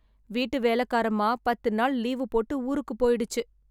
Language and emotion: Tamil, sad